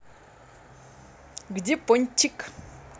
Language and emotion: Russian, positive